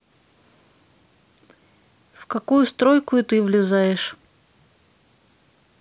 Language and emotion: Russian, neutral